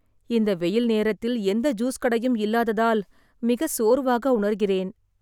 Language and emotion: Tamil, sad